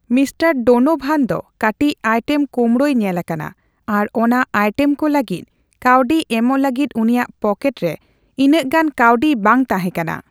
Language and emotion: Santali, neutral